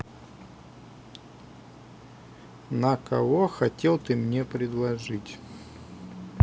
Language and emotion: Russian, neutral